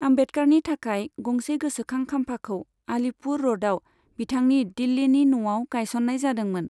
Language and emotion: Bodo, neutral